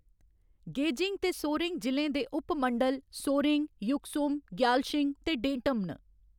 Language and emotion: Dogri, neutral